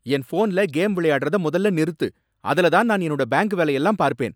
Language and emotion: Tamil, angry